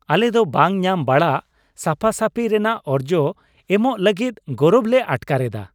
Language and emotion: Santali, happy